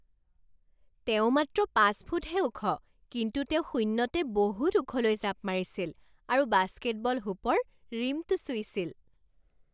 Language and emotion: Assamese, surprised